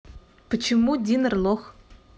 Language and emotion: Russian, neutral